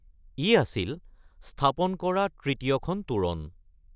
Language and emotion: Assamese, neutral